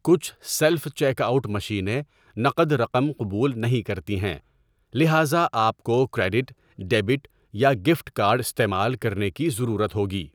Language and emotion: Urdu, neutral